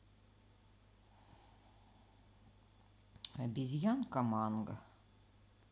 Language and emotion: Russian, neutral